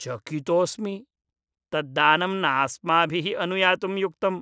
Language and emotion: Sanskrit, disgusted